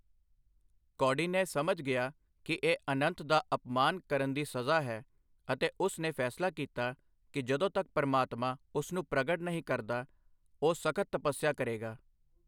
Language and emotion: Punjabi, neutral